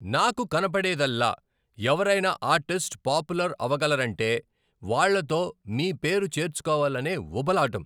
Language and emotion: Telugu, angry